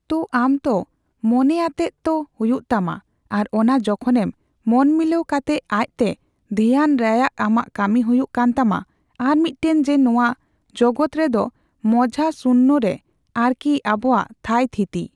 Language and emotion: Santali, neutral